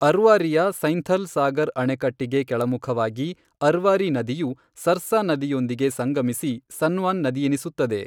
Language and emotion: Kannada, neutral